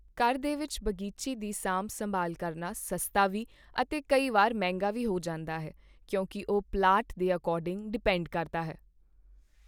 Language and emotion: Punjabi, neutral